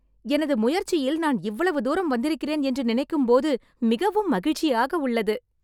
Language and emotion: Tamil, happy